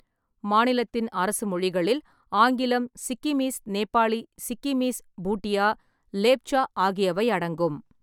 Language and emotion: Tamil, neutral